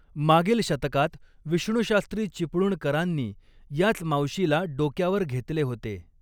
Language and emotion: Marathi, neutral